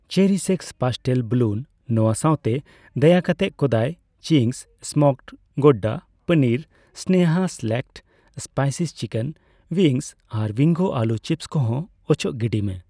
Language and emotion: Santali, neutral